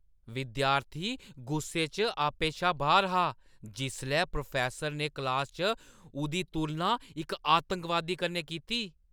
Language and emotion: Dogri, angry